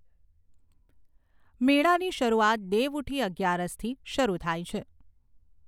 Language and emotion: Gujarati, neutral